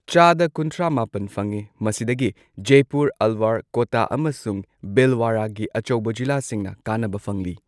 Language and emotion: Manipuri, neutral